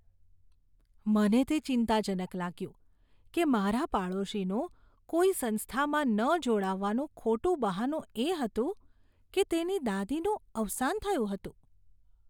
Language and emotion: Gujarati, disgusted